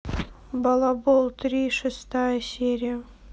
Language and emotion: Russian, neutral